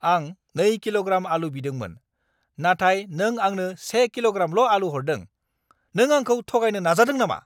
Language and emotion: Bodo, angry